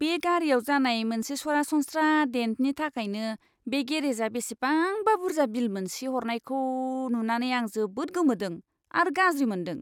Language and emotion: Bodo, disgusted